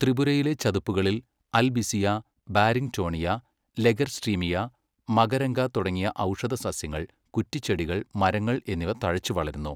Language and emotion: Malayalam, neutral